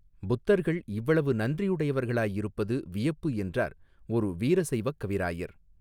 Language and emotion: Tamil, neutral